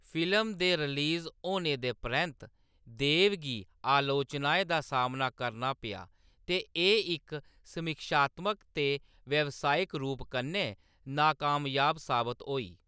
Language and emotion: Dogri, neutral